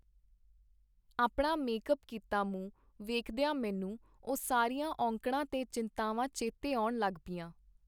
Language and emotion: Punjabi, neutral